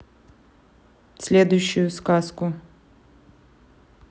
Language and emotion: Russian, neutral